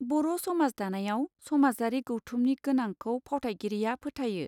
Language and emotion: Bodo, neutral